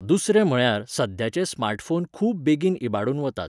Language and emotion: Goan Konkani, neutral